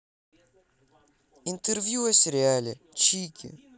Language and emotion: Russian, neutral